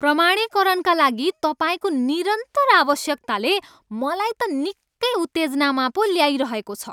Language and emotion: Nepali, angry